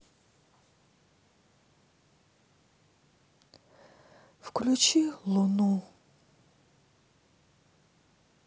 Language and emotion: Russian, sad